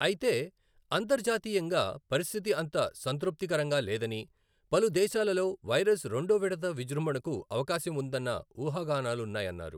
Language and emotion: Telugu, neutral